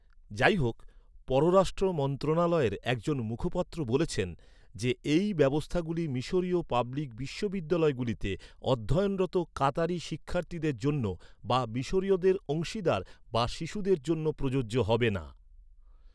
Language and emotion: Bengali, neutral